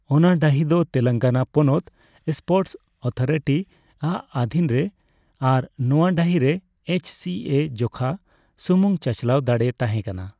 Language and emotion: Santali, neutral